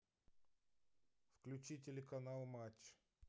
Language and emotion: Russian, neutral